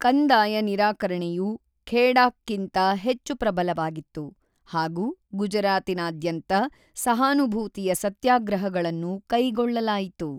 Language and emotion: Kannada, neutral